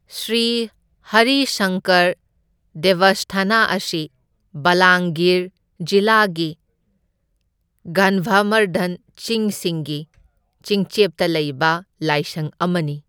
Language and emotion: Manipuri, neutral